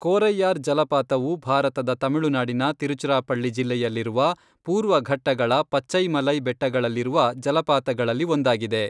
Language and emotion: Kannada, neutral